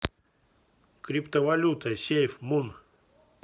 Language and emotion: Russian, neutral